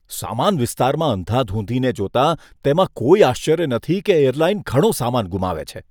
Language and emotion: Gujarati, disgusted